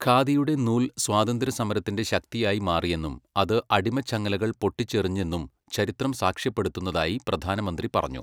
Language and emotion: Malayalam, neutral